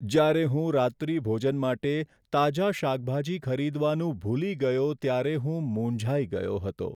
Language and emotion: Gujarati, sad